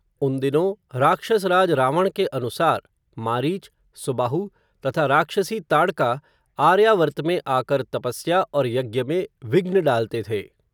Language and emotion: Hindi, neutral